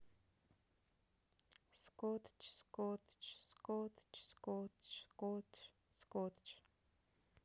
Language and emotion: Russian, sad